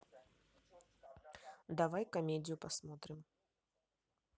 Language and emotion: Russian, neutral